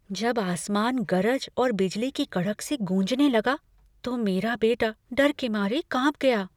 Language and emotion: Hindi, fearful